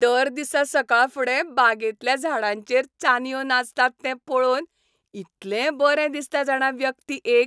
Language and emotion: Goan Konkani, happy